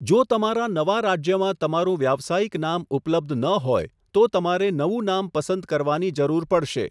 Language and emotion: Gujarati, neutral